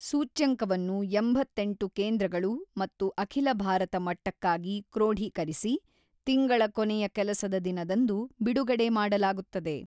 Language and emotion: Kannada, neutral